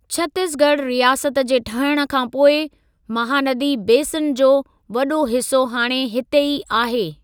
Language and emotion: Sindhi, neutral